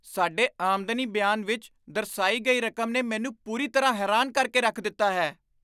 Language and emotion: Punjabi, surprised